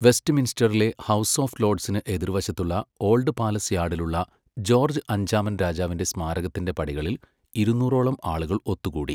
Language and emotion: Malayalam, neutral